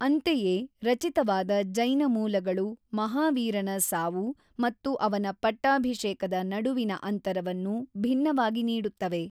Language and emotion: Kannada, neutral